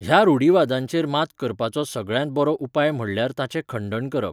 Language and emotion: Goan Konkani, neutral